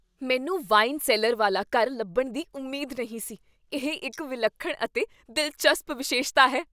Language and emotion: Punjabi, surprised